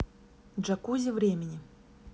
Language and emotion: Russian, neutral